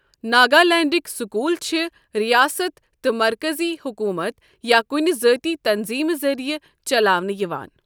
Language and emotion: Kashmiri, neutral